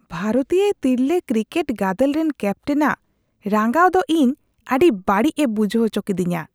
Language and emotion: Santali, disgusted